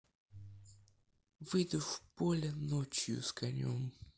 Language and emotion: Russian, neutral